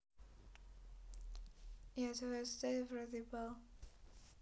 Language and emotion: Russian, neutral